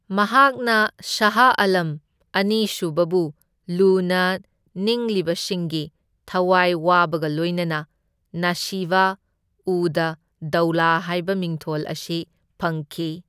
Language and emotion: Manipuri, neutral